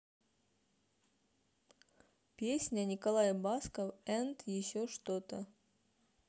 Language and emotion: Russian, neutral